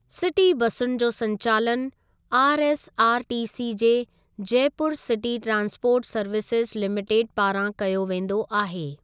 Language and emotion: Sindhi, neutral